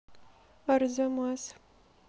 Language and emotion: Russian, neutral